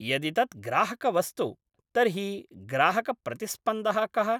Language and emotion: Sanskrit, neutral